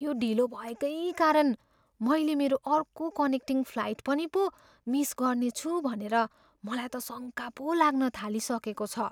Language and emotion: Nepali, fearful